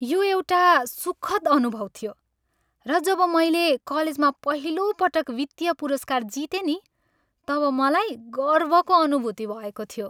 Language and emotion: Nepali, happy